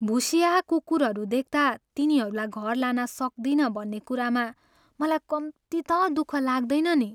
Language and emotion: Nepali, sad